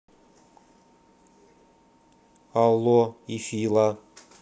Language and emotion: Russian, neutral